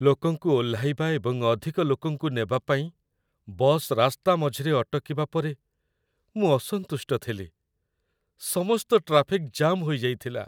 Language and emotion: Odia, sad